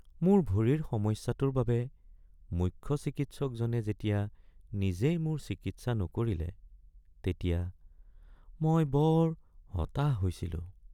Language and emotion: Assamese, sad